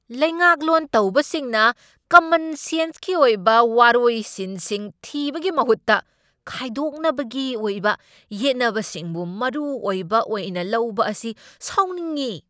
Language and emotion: Manipuri, angry